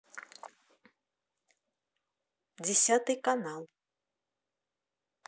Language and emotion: Russian, neutral